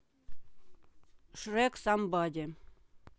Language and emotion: Russian, neutral